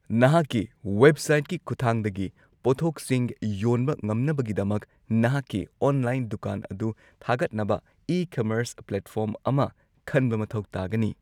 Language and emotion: Manipuri, neutral